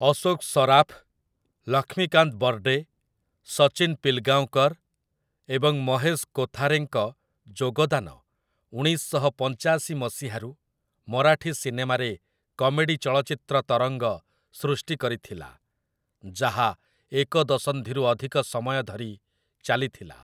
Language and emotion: Odia, neutral